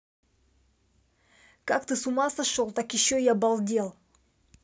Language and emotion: Russian, angry